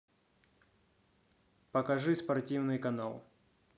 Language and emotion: Russian, neutral